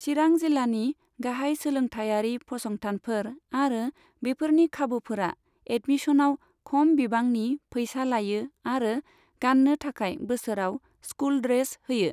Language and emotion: Bodo, neutral